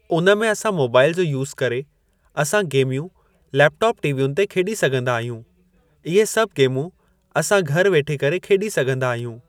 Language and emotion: Sindhi, neutral